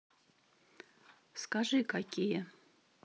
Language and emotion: Russian, neutral